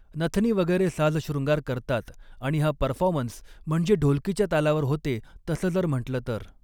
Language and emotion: Marathi, neutral